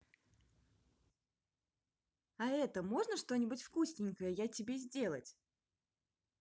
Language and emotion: Russian, positive